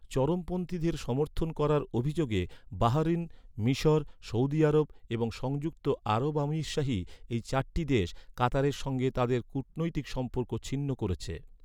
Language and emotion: Bengali, neutral